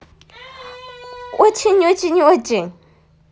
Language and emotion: Russian, positive